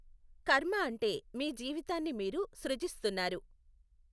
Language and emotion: Telugu, neutral